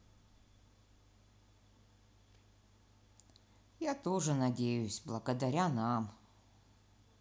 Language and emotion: Russian, sad